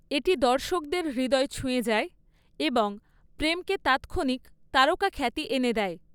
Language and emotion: Bengali, neutral